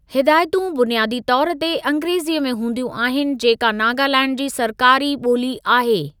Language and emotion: Sindhi, neutral